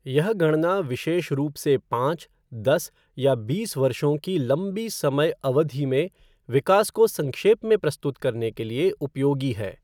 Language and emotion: Hindi, neutral